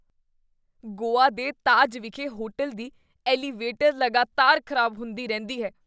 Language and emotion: Punjabi, disgusted